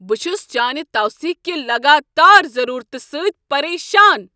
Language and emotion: Kashmiri, angry